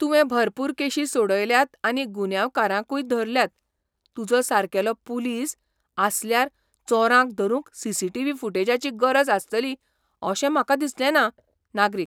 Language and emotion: Goan Konkani, surprised